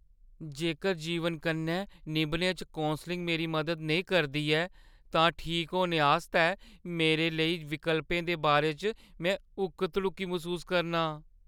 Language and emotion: Dogri, fearful